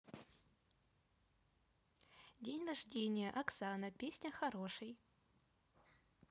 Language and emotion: Russian, neutral